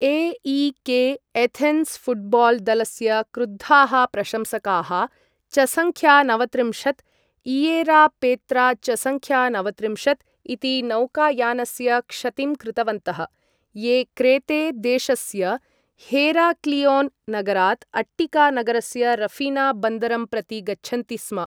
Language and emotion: Sanskrit, neutral